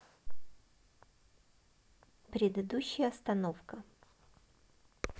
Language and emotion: Russian, neutral